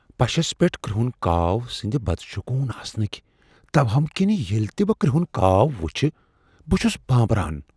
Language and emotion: Kashmiri, fearful